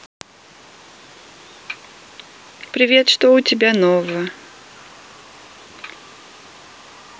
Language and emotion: Russian, neutral